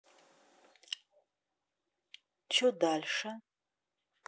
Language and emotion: Russian, neutral